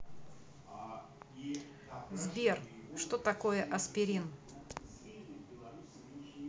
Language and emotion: Russian, neutral